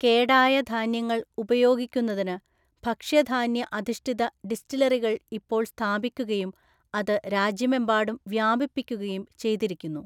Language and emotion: Malayalam, neutral